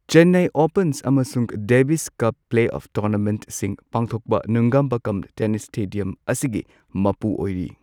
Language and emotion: Manipuri, neutral